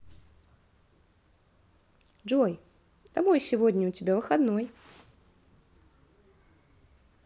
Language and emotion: Russian, positive